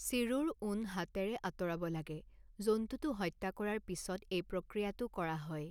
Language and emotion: Assamese, neutral